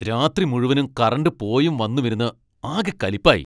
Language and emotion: Malayalam, angry